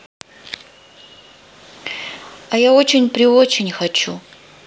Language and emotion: Russian, sad